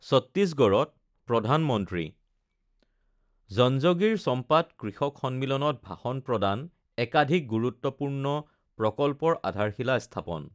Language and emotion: Assamese, neutral